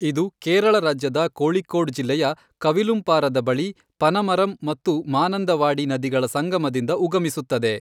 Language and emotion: Kannada, neutral